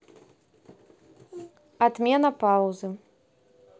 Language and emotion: Russian, neutral